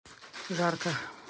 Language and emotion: Russian, neutral